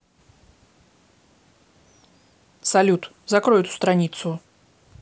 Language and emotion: Russian, angry